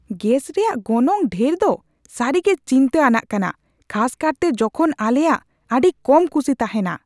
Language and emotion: Santali, angry